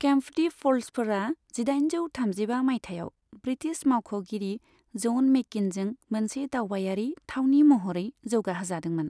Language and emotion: Bodo, neutral